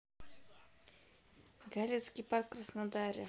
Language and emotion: Russian, neutral